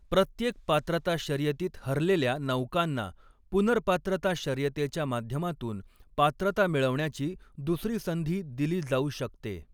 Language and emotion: Marathi, neutral